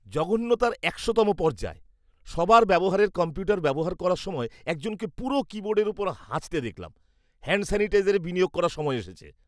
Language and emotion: Bengali, disgusted